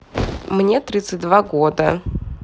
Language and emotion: Russian, neutral